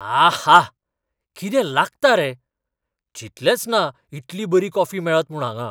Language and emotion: Goan Konkani, surprised